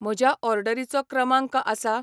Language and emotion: Goan Konkani, neutral